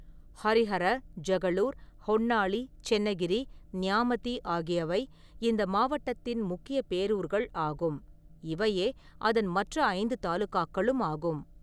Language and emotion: Tamil, neutral